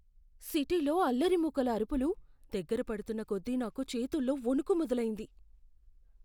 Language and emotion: Telugu, fearful